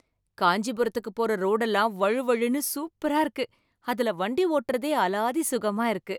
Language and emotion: Tamil, happy